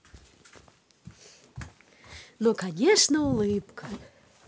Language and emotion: Russian, positive